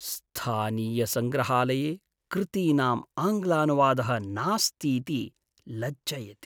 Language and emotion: Sanskrit, sad